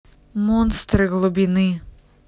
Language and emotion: Russian, neutral